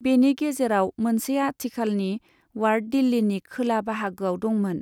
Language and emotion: Bodo, neutral